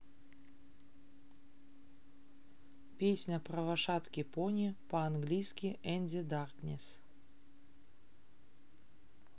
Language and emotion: Russian, neutral